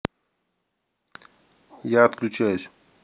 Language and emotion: Russian, neutral